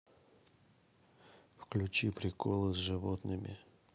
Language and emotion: Russian, neutral